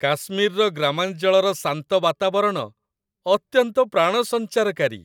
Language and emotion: Odia, happy